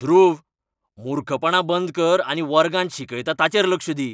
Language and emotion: Goan Konkani, angry